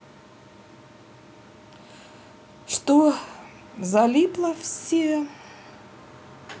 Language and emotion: Russian, neutral